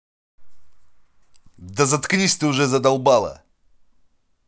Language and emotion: Russian, angry